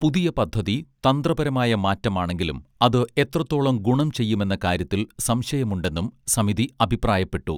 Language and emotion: Malayalam, neutral